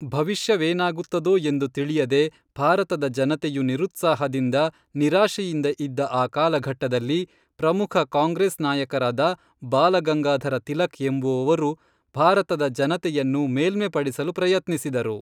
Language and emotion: Kannada, neutral